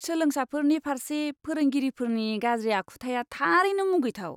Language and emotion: Bodo, disgusted